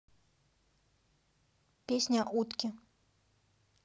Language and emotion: Russian, neutral